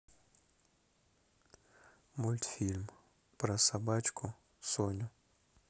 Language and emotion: Russian, neutral